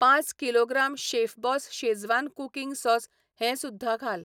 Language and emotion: Goan Konkani, neutral